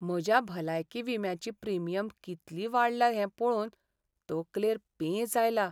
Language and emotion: Goan Konkani, sad